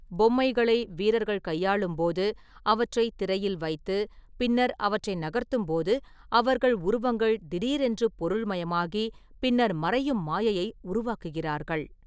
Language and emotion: Tamil, neutral